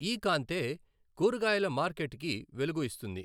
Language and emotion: Telugu, neutral